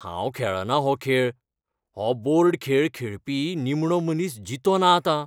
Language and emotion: Goan Konkani, fearful